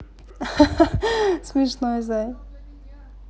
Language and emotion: Russian, positive